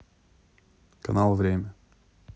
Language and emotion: Russian, neutral